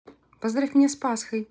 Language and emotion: Russian, positive